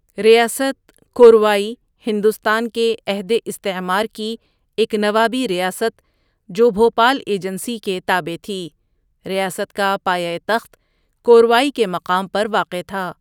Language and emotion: Urdu, neutral